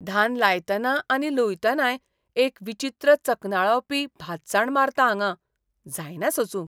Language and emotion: Goan Konkani, disgusted